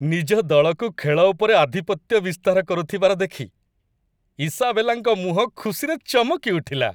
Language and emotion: Odia, happy